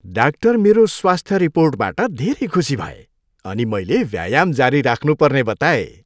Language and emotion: Nepali, happy